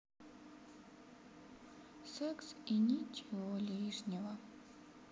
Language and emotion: Russian, sad